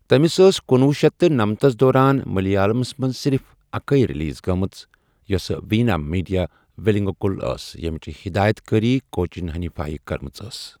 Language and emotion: Kashmiri, neutral